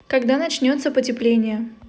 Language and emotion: Russian, neutral